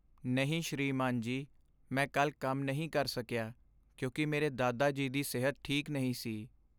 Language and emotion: Punjabi, sad